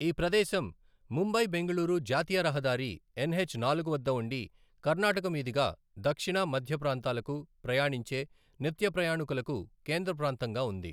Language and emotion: Telugu, neutral